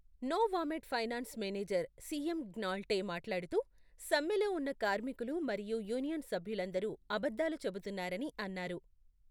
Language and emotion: Telugu, neutral